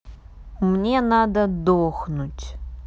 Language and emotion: Russian, sad